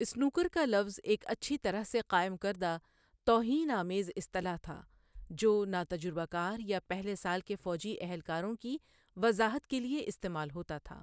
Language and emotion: Urdu, neutral